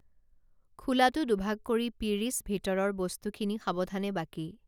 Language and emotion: Assamese, neutral